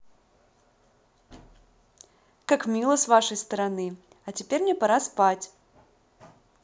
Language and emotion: Russian, positive